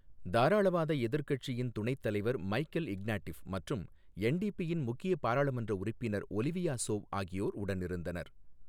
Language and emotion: Tamil, neutral